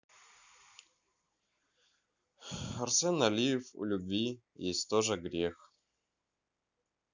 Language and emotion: Russian, neutral